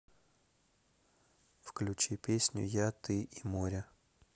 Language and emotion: Russian, neutral